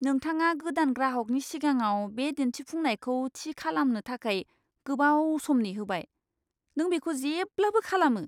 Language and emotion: Bodo, disgusted